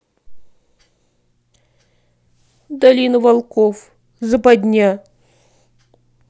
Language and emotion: Russian, sad